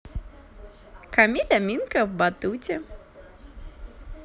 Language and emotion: Russian, positive